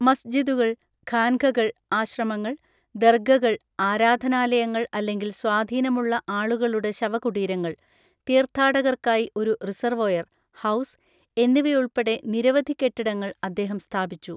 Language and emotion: Malayalam, neutral